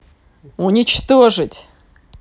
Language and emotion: Russian, angry